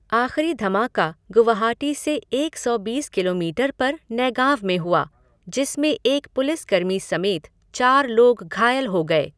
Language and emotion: Hindi, neutral